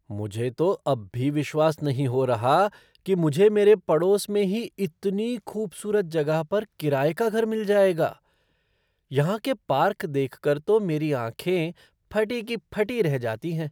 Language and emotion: Hindi, surprised